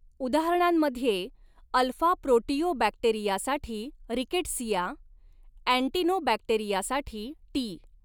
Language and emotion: Marathi, neutral